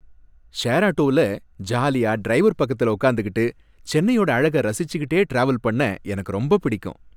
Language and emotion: Tamil, happy